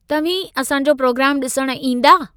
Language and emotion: Sindhi, neutral